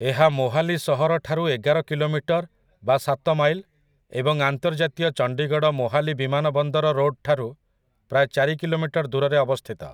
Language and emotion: Odia, neutral